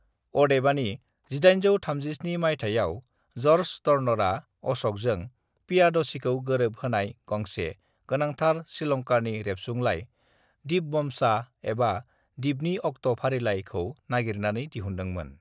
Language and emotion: Bodo, neutral